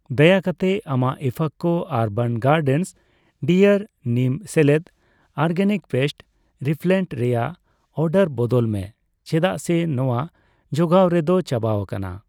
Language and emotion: Santali, neutral